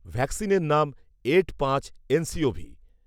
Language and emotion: Bengali, neutral